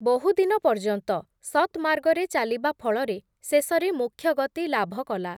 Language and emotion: Odia, neutral